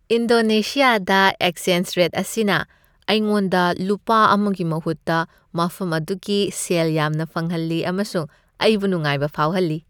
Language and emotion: Manipuri, happy